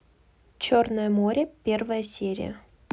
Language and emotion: Russian, neutral